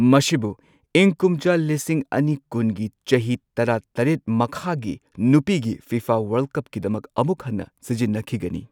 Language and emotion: Manipuri, neutral